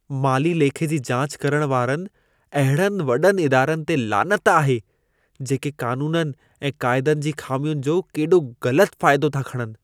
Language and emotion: Sindhi, disgusted